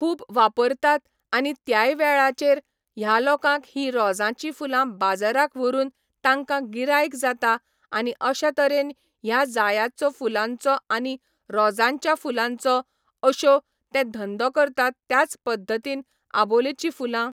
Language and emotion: Goan Konkani, neutral